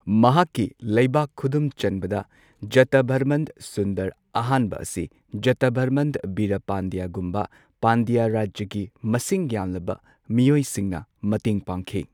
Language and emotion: Manipuri, neutral